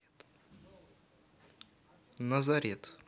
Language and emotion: Russian, neutral